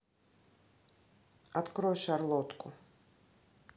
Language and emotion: Russian, neutral